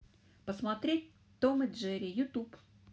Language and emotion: Russian, neutral